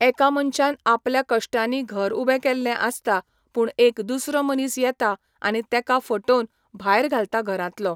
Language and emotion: Goan Konkani, neutral